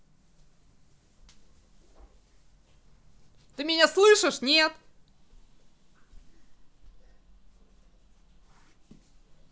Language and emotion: Russian, angry